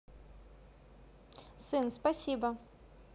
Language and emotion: Russian, positive